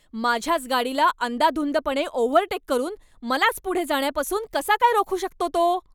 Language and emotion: Marathi, angry